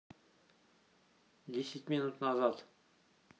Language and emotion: Russian, neutral